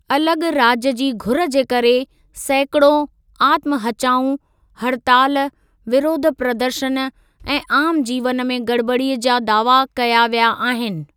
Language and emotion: Sindhi, neutral